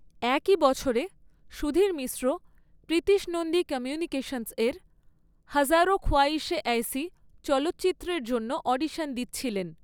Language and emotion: Bengali, neutral